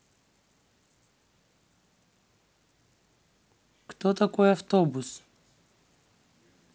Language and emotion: Russian, neutral